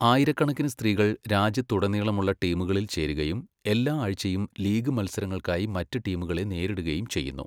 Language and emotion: Malayalam, neutral